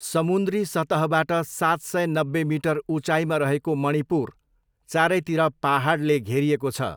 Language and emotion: Nepali, neutral